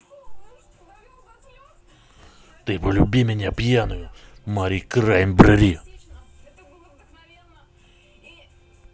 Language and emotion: Russian, angry